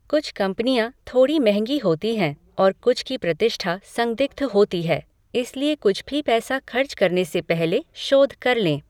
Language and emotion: Hindi, neutral